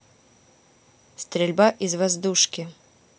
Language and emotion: Russian, neutral